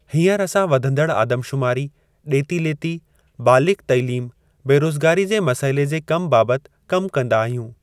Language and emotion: Sindhi, neutral